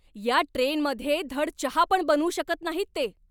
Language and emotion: Marathi, angry